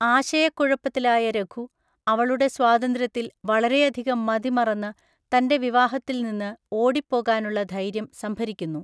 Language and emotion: Malayalam, neutral